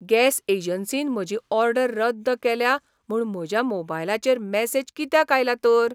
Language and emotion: Goan Konkani, surprised